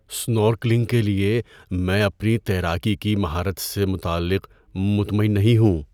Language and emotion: Urdu, fearful